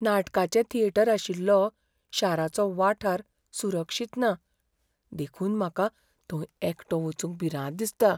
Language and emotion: Goan Konkani, fearful